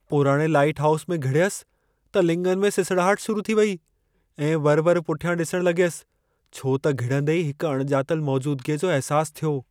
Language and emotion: Sindhi, fearful